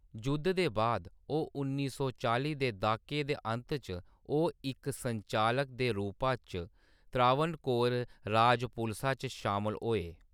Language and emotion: Dogri, neutral